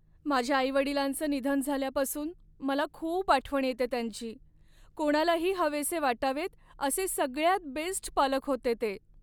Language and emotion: Marathi, sad